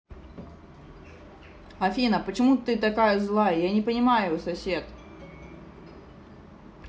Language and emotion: Russian, angry